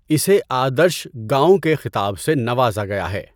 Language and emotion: Urdu, neutral